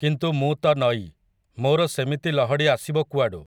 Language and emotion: Odia, neutral